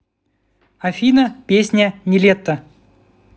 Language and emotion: Russian, neutral